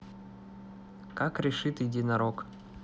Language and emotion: Russian, neutral